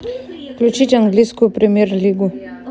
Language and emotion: Russian, neutral